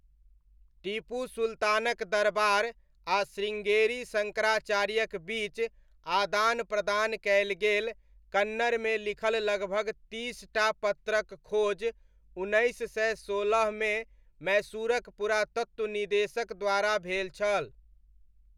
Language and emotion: Maithili, neutral